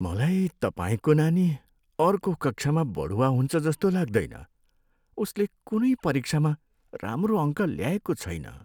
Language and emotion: Nepali, sad